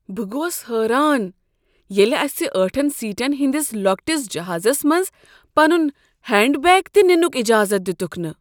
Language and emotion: Kashmiri, surprised